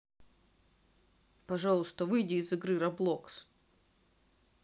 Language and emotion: Russian, neutral